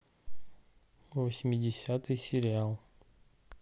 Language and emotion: Russian, neutral